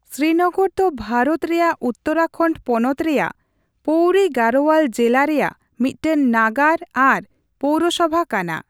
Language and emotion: Santali, neutral